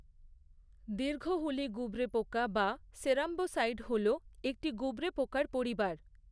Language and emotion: Bengali, neutral